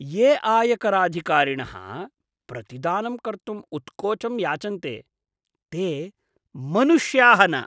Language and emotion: Sanskrit, disgusted